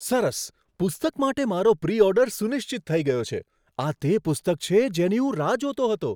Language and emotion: Gujarati, surprised